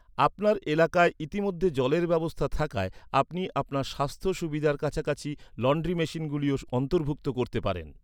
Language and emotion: Bengali, neutral